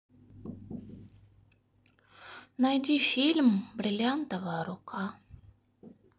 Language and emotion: Russian, sad